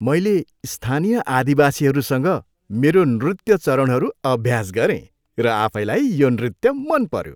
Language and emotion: Nepali, happy